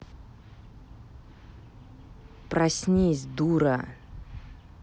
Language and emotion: Russian, angry